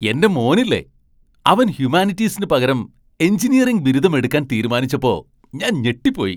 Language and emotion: Malayalam, surprised